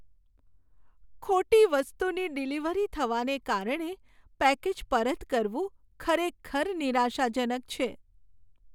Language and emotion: Gujarati, sad